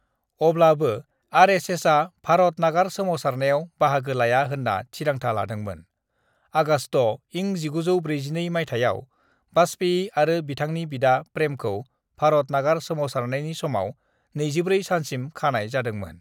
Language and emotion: Bodo, neutral